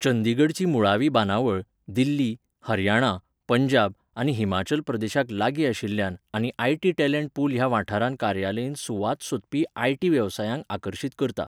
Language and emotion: Goan Konkani, neutral